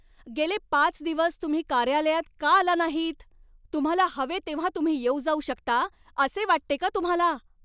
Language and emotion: Marathi, angry